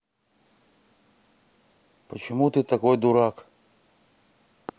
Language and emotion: Russian, neutral